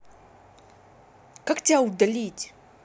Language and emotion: Russian, angry